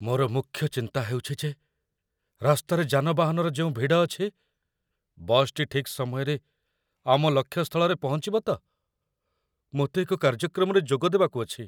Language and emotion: Odia, fearful